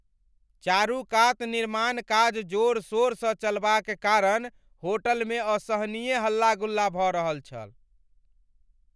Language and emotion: Maithili, angry